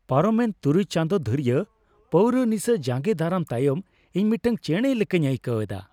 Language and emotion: Santali, happy